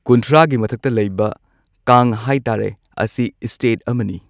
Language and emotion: Manipuri, neutral